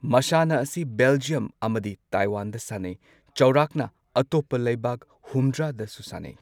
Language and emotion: Manipuri, neutral